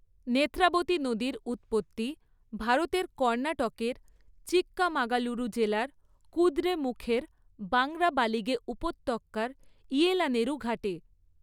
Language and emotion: Bengali, neutral